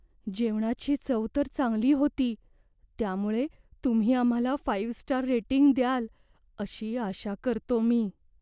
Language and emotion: Marathi, fearful